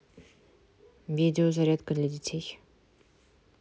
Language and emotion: Russian, neutral